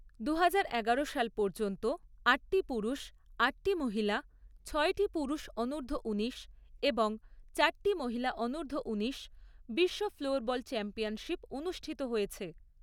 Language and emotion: Bengali, neutral